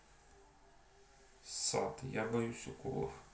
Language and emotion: Russian, neutral